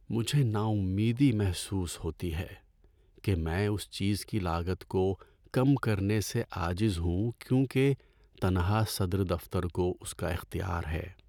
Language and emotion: Urdu, sad